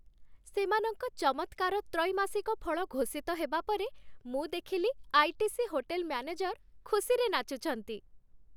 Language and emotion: Odia, happy